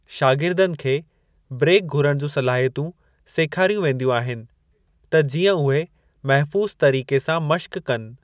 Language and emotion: Sindhi, neutral